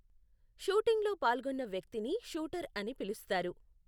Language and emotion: Telugu, neutral